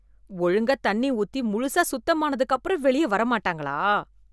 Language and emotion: Tamil, disgusted